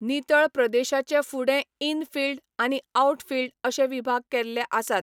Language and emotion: Goan Konkani, neutral